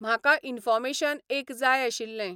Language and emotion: Goan Konkani, neutral